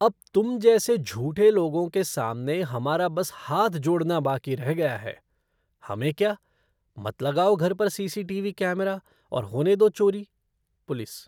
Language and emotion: Hindi, disgusted